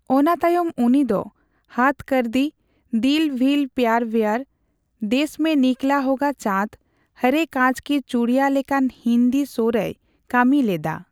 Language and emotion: Santali, neutral